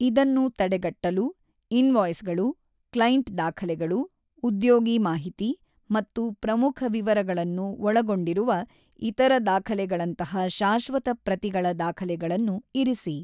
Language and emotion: Kannada, neutral